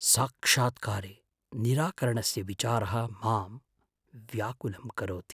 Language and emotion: Sanskrit, fearful